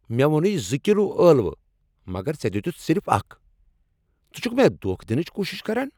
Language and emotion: Kashmiri, angry